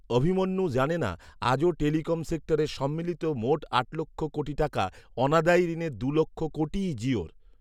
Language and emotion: Bengali, neutral